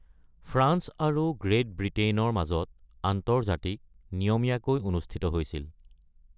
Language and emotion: Assamese, neutral